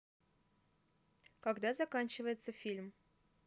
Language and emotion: Russian, neutral